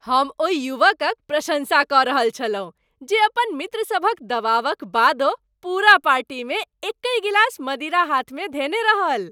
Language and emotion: Maithili, happy